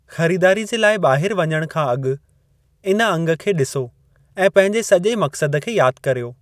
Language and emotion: Sindhi, neutral